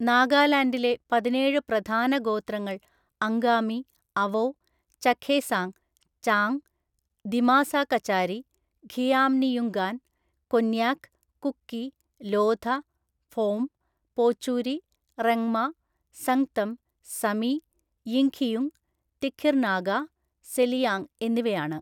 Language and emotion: Malayalam, neutral